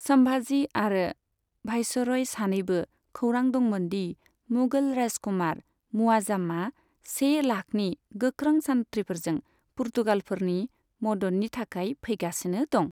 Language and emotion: Bodo, neutral